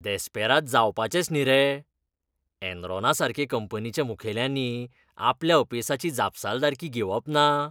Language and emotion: Goan Konkani, disgusted